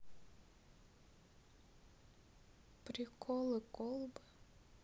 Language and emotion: Russian, sad